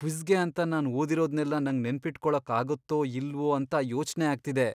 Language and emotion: Kannada, fearful